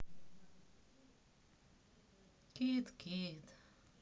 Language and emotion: Russian, sad